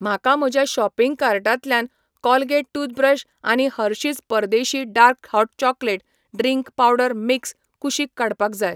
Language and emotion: Goan Konkani, neutral